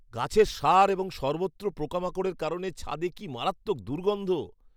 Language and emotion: Bengali, disgusted